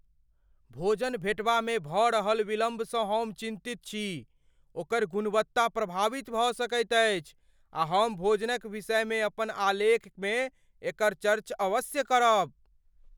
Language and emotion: Maithili, fearful